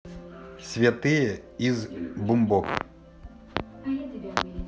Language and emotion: Russian, neutral